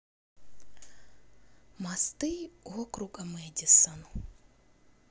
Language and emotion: Russian, sad